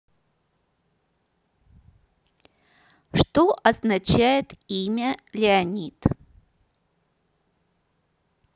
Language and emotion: Russian, neutral